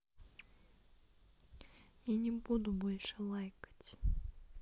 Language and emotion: Russian, sad